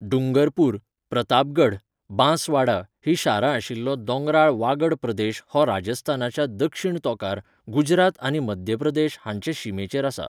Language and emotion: Goan Konkani, neutral